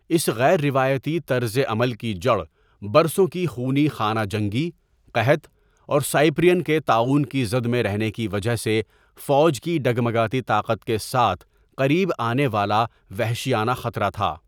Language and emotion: Urdu, neutral